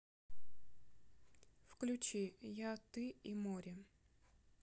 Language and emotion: Russian, neutral